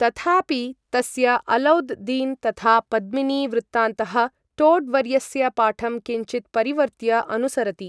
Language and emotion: Sanskrit, neutral